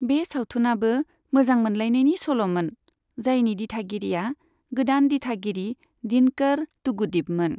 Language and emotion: Bodo, neutral